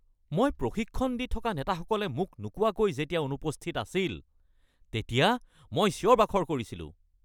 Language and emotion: Assamese, angry